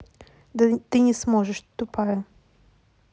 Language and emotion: Russian, neutral